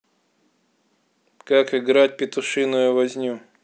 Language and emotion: Russian, neutral